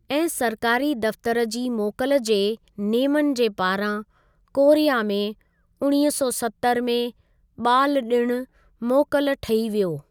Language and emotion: Sindhi, neutral